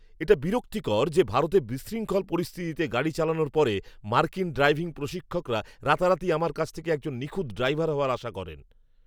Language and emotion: Bengali, angry